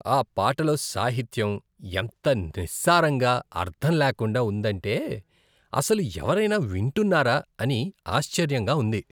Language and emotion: Telugu, disgusted